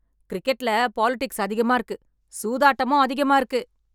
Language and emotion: Tamil, angry